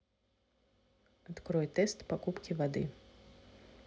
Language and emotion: Russian, neutral